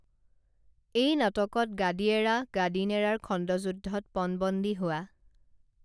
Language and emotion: Assamese, neutral